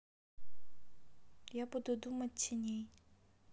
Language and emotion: Russian, sad